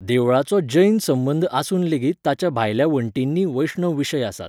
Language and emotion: Goan Konkani, neutral